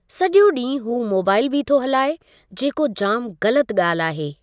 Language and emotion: Sindhi, neutral